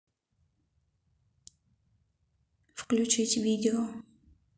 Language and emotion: Russian, neutral